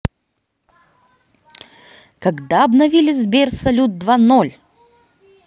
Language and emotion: Russian, positive